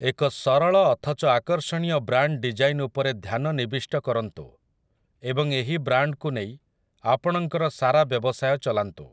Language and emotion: Odia, neutral